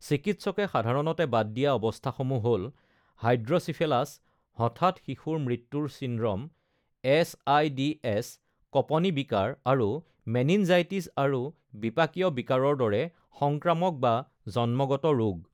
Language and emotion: Assamese, neutral